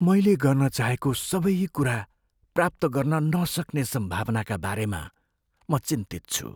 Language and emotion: Nepali, fearful